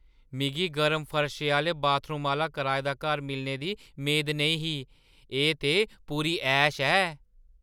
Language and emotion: Dogri, surprised